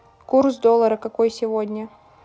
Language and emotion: Russian, neutral